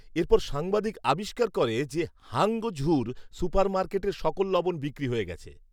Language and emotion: Bengali, neutral